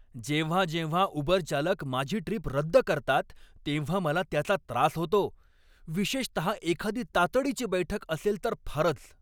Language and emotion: Marathi, angry